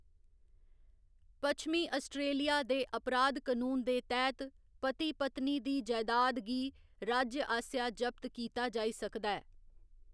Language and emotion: Dogri, neutral